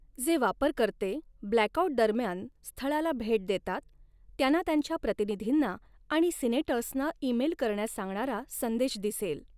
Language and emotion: Marathi, neutral